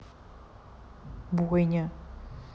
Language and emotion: Russian, neutral